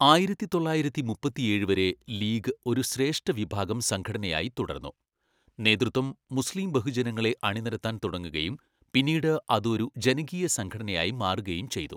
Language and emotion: Malayalam, neutral